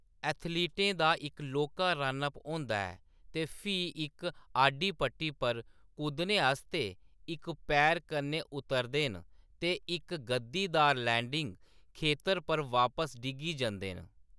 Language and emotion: Dogri, neutral